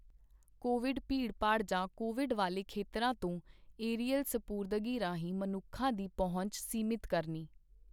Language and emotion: Punjabi, neutral